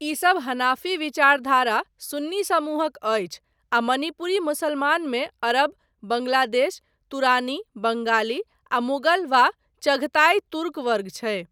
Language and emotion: Maithili, neutral